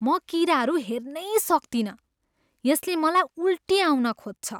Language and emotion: Nepali, disgusted